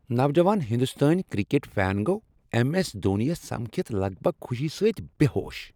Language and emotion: Kashmiri, happy